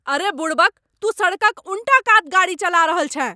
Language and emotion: Maithili, angry